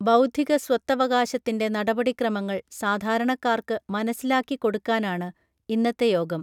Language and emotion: Malayalam, neutral